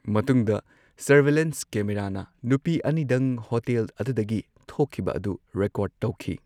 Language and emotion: Manipuri, neutral